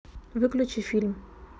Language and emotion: Russian, neutral